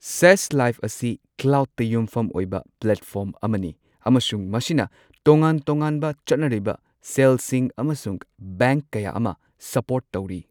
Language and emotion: Manipuri, neutral